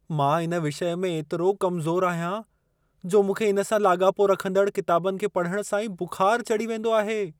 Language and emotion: Sindhi, fearful